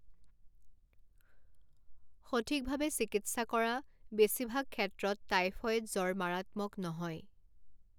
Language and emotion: Assamese, neutral